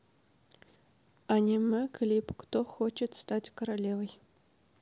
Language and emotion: Russian, neutral